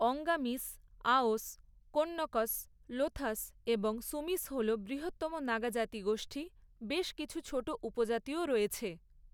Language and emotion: Bengali, neutral